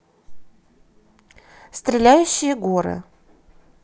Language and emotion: Russian, neutral